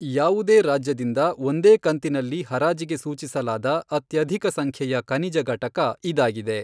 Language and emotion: Kannada, neutral